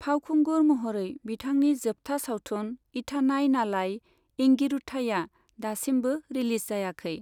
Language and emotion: Bodo, neutral